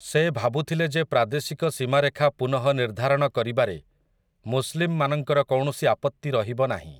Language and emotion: Odia, neutral